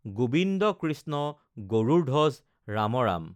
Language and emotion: Assamese, neutral